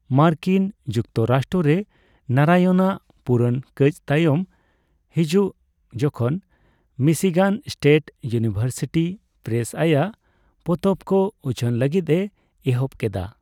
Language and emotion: Santali, neutral